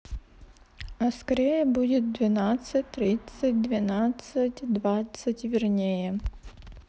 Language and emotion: Russian, neutral